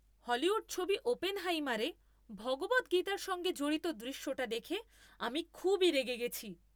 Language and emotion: Bengali, angry